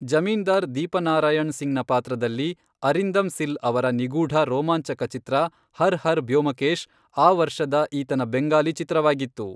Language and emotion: Kannada, neutral